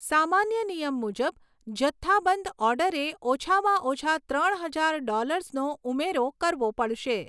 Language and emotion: Gujarati, neutral